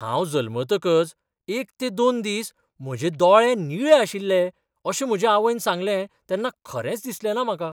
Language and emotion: Goan Konkani, surprised